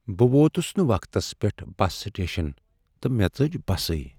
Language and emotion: Kashmiri, sad